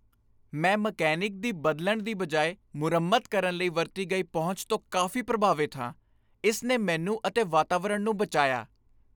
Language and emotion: Punjabi, happy